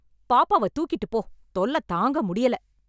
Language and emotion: Tamil, angry